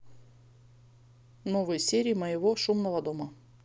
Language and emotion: Russian, neutral